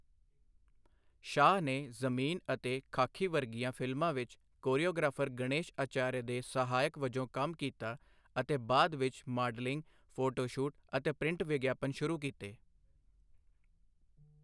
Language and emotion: Punjabi, neutral